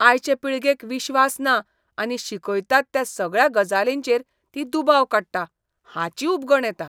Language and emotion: Goan Konkani, disgusted